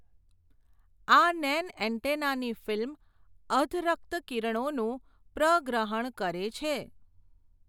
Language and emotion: Gujarati, neutral